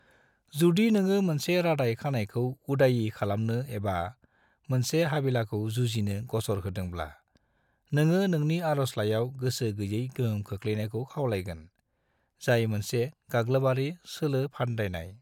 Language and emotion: Bodo, neutral